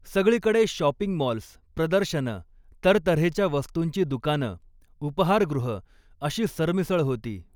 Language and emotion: Marathi, neutral